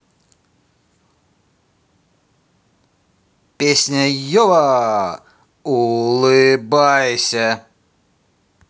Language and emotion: Russian, positive